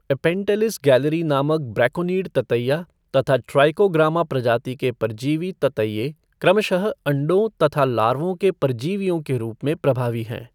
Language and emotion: Hindi, neutral